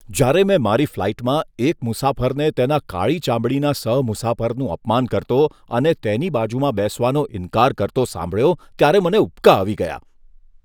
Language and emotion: Gujarati, disgusted